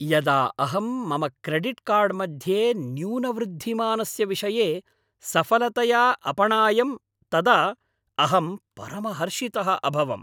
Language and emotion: Sanskrit, happy